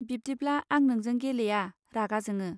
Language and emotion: Bodo, neutral